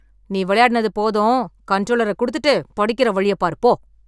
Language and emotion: Tamil, angry